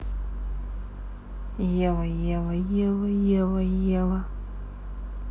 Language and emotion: Russian, neutral